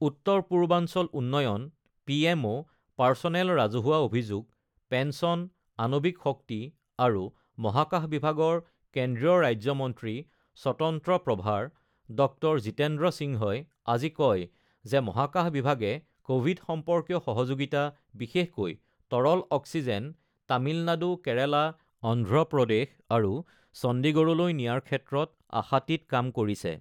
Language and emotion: Assamese, neutral